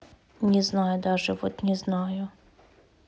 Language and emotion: Russian, neutral